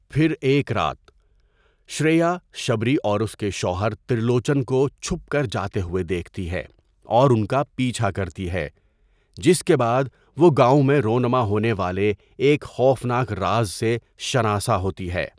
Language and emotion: Urdu, neutral